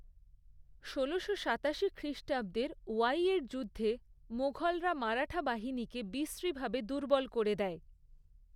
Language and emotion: Bengali, neutral